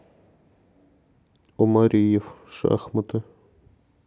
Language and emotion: Russian, neutral